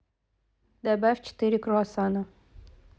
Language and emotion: Russian, neutral